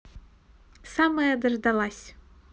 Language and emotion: Russian, positive